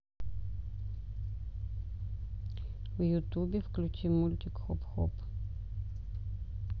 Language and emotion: Russian, neutral